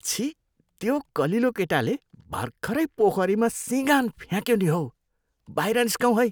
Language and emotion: Nepali, disgusted